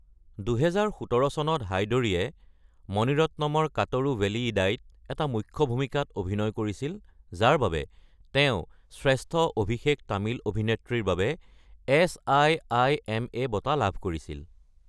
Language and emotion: Assamese, neutral